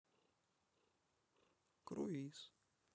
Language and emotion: Russian, neutral